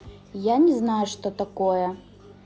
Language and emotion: Russian, neutral